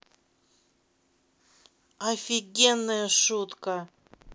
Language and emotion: Russian, neutral